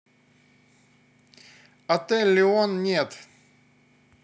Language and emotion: Russian, neutral